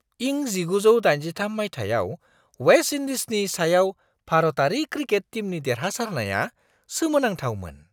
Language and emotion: Bodo, surprised